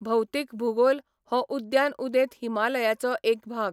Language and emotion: Goan Konkani, neutral